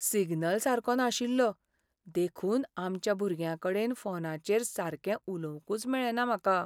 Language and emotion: Goan Konkani, sad